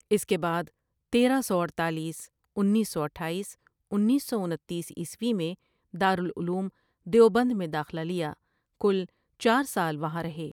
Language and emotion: Urdu, neutral